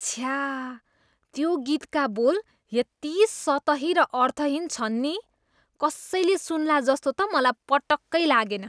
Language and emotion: Nepali, disgusted